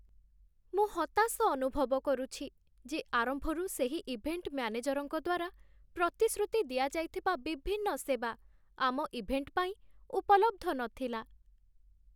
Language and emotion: Odia, sad